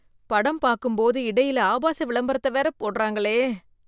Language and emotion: Tamil, disgusted